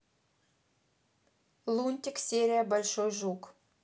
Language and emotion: Russian, neutral